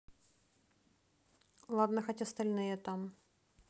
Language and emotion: Russian, neutral